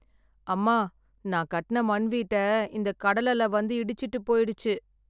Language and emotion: Tamil, sad